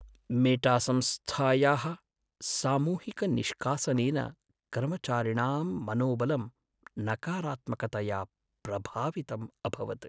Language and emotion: Sanskrit, sad